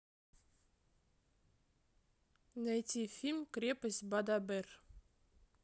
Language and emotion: Russian, neutral